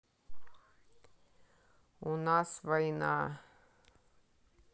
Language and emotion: Russian, neutral